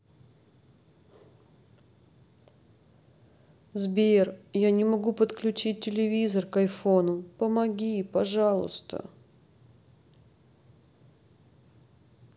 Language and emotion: Russian, sad